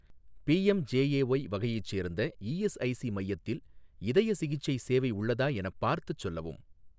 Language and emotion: Tamil, neutral